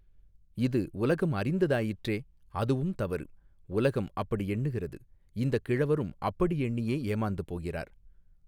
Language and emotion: Tamil, neutral